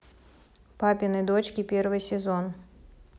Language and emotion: Russian, neutral